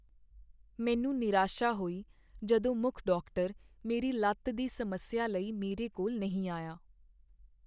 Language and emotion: Punjabi, sad